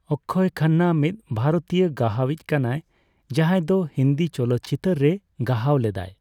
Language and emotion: Santali, neutral